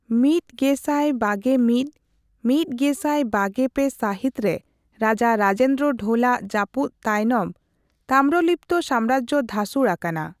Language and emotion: Santali, neutral